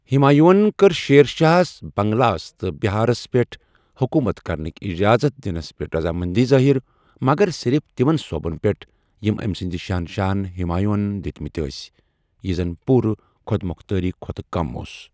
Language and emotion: Kashmiri, neutral